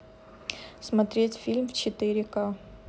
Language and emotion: Russian, neutral